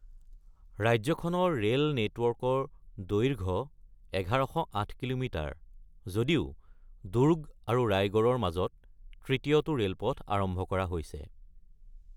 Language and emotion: Assamese, neutral